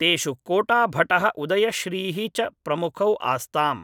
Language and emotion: Sanskrit, neutral